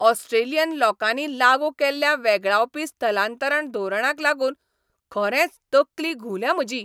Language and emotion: Goan Konkani, angry